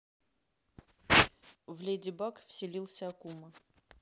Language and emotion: Russian, neutral